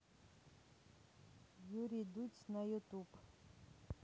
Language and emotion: Russian, neutral